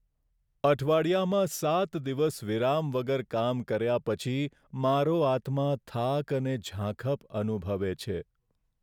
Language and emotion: Gujarati, sad